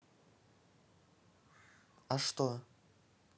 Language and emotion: Russian, neutral